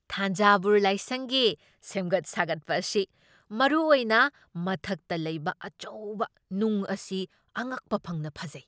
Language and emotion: Manipuri, surprised